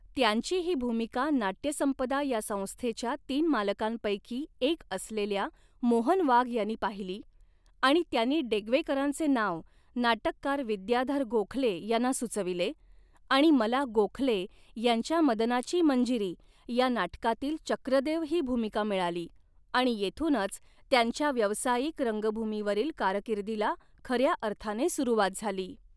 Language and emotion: Marathi, neutral